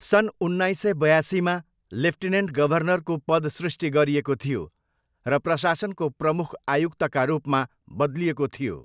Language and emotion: Nepali, neutral